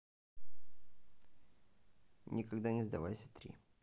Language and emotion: Russian, neutral